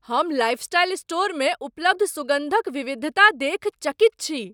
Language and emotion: Maithili, surprised